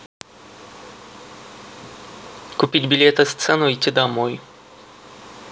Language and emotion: Russian, neutral